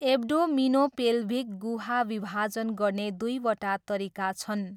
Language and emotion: Nepali, neutral